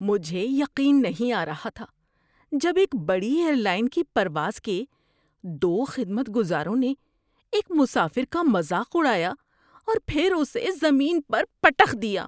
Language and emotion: Urdu, disgusted